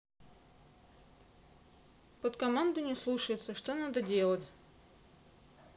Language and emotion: Russian, neutral